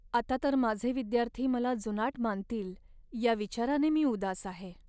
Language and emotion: Marathi, sad